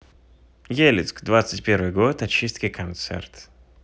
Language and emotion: Russian, neutral